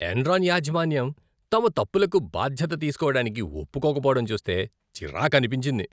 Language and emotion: Telugu, disgusted